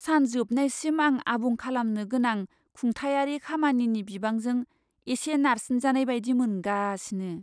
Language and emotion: Bodo, fearful